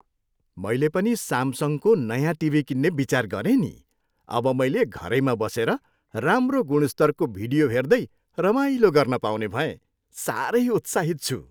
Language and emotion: Nepali, happy